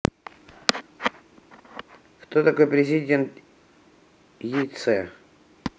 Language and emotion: Russian, neutral